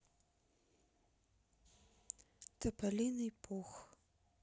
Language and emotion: Russian, sad